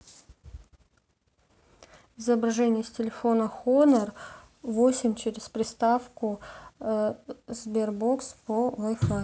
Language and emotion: Russian, neutral